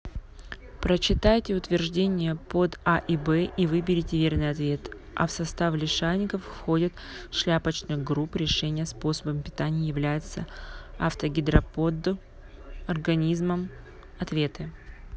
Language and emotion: Russian, neutral